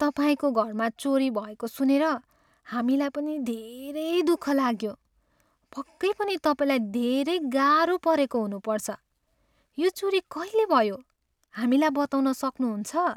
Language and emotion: Nepali, sad